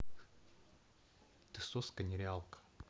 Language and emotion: Russian, neutral